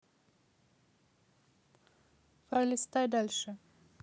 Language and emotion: Russian, neutral